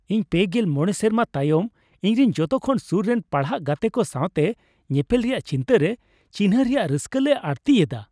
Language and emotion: Santali, happy